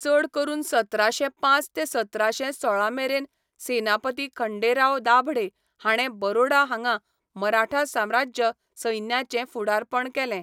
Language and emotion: Goan Konkani, neutral